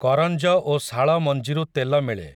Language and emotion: Odia, neutral